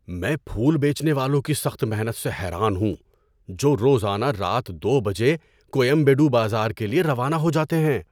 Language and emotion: Urdu, surprised